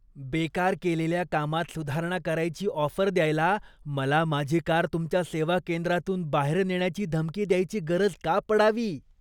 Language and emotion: Marathi, disgusted